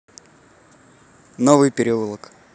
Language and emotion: Russian, neutral